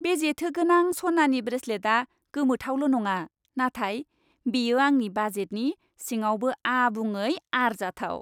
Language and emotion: Bodo, happy